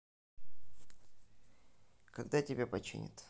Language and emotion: Russian, neutral